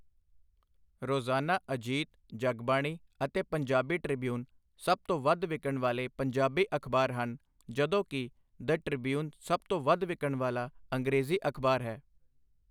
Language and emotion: Punjabi, neutral